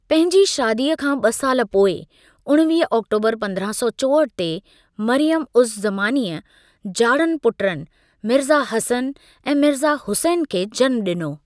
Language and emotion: Sindhi, neutral